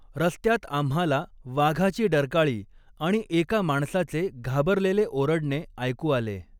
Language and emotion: Marathi, neutral